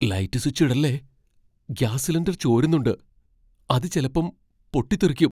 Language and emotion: Malayalam, fearful